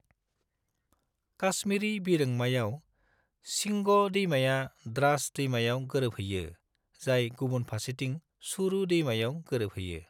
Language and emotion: Bodo, neutral